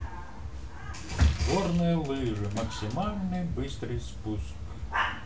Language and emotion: Russian, neutral